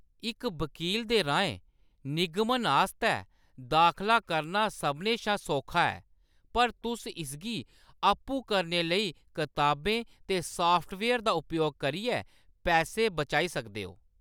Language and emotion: Dogri, neutral